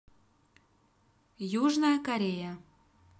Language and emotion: Russian, neutral